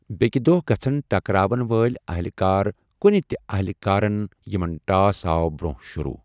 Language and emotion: Kashmiri, neutral